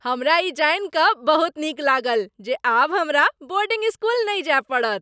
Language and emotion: Maithili, happy